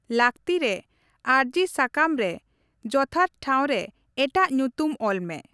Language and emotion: Santali, neutral